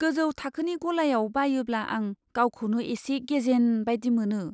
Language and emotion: Bodo, fearful